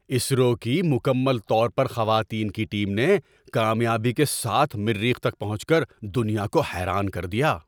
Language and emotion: Urdu, surprised